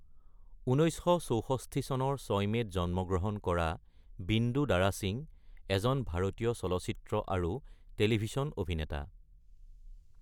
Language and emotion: Assamese, neutral